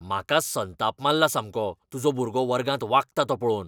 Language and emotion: Goan Konkani, angry